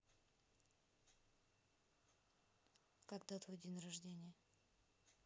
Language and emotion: Russian, neutral